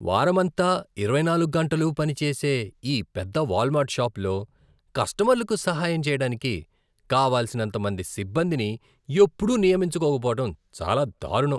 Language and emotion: Telugu, disgusted